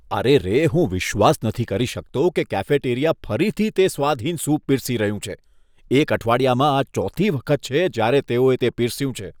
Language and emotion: Gujarati, disgusted